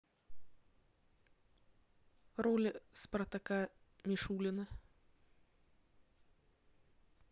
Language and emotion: Russian, neutral